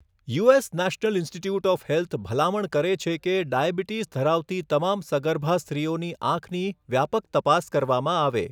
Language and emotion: Gujarati, neutral